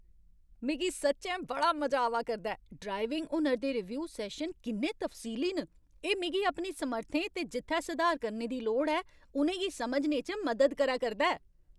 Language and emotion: Dogri, happy